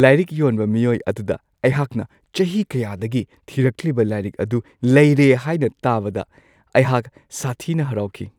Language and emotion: Manipuri, happy